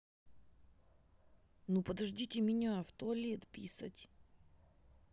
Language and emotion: Russian, neutral